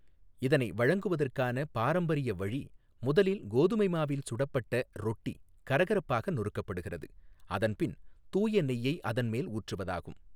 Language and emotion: Tamil, neutral